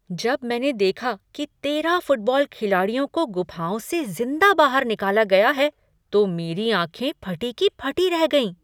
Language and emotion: Hindi, surprised